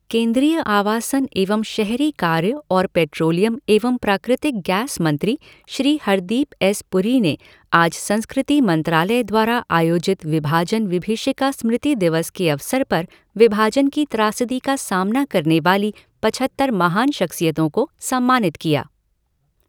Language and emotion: Hindi, neutral